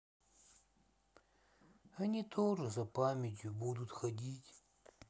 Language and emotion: Russian, sad